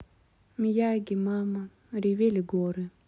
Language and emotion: Russian, sad